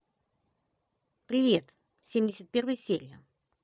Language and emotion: Russian, positive